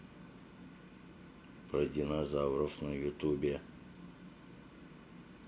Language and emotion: Russian, neutral